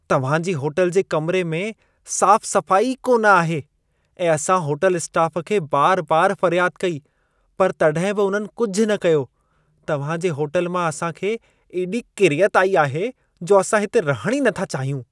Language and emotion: Sindhi, disgusted